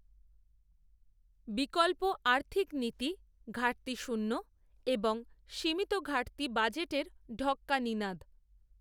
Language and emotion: Bengali, neutral